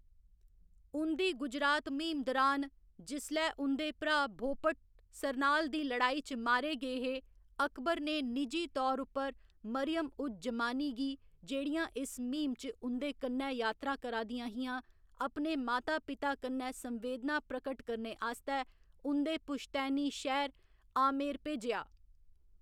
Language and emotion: Dogri, neutral